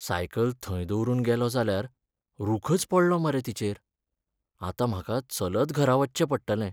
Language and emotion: Goan Konkani, sad